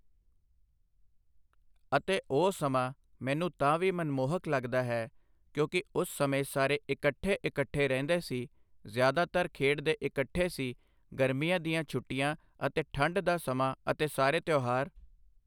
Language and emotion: Punjabi, neutral